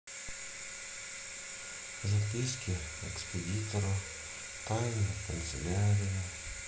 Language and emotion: Russian, sad